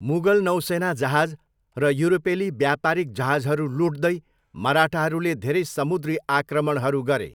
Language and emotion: Nepali, neutral